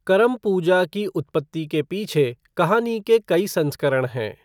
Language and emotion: Hindi, neutral